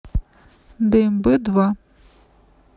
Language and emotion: Russian, neutral